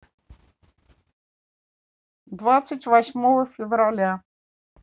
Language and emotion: Russian, neutral